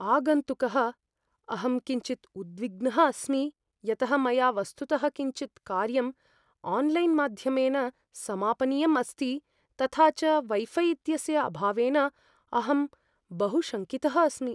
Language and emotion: Sanskrit, fearful